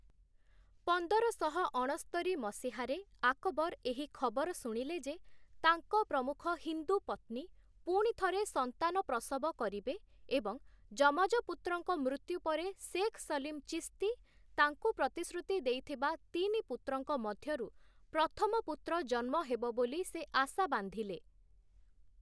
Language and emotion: Odia, neutral